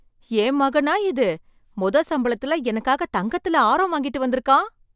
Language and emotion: Tamil, surprised